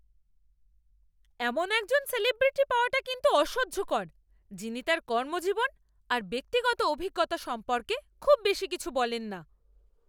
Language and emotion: Bengali, angry